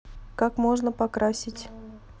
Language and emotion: Russian, neutral